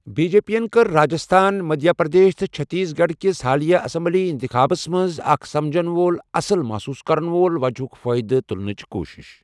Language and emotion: Kashmiri, neutral